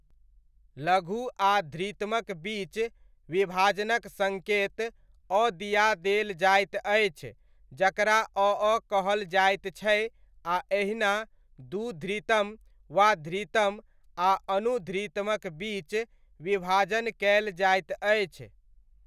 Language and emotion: Maithili, neutral